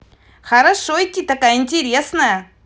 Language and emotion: Russian, positive